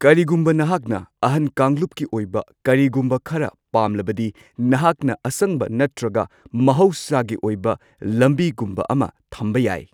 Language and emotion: Manipuri, neutral